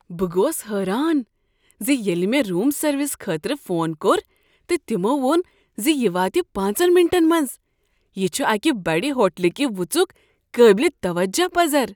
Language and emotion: Kashmiri, surprised